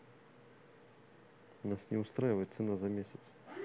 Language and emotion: Russian, neutral